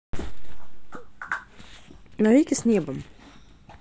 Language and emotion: Russian, neutral